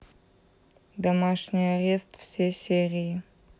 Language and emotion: Russian, neutral